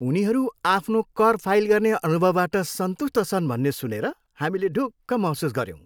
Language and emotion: Nepali, happy